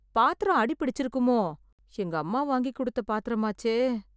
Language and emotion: Tamil, fearful